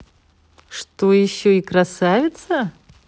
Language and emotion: Russian, positive